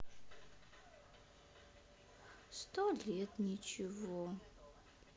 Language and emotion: Russian, sad